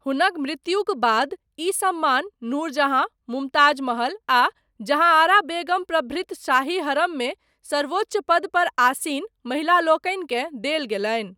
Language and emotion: Maithili, neutral